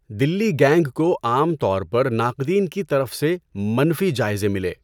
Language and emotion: Urdu, neutral